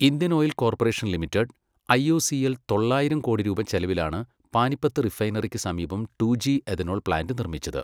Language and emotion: Malayalam, neutral